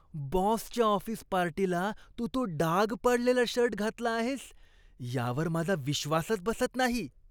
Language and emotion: Marathi, disgusted